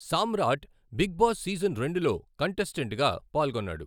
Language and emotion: Telugu, neutral